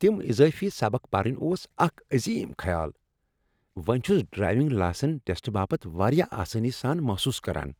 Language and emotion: Kashmiri, happy